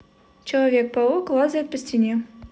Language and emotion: Russian, neutral